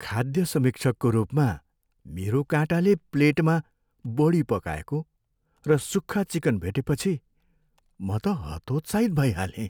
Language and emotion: Nepali, sad